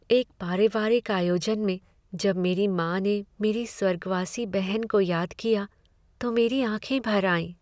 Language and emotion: Hindi, sad